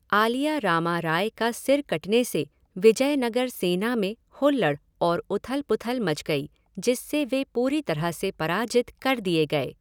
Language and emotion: Hindi, neutral